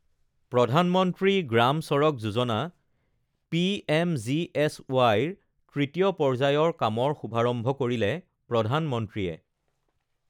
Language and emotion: Assamese, neutral